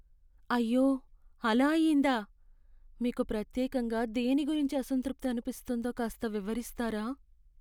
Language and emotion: Telugu, sad